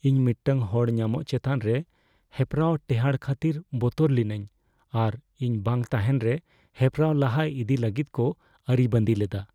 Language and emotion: Santali, fearful